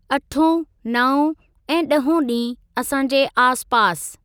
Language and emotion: Sindhi, neutral